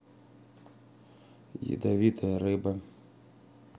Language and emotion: Russian, sad